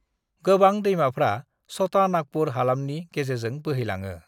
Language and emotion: Bodo, neutral